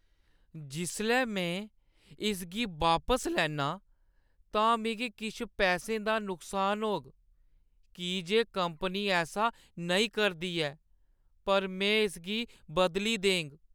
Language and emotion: Dogri, sad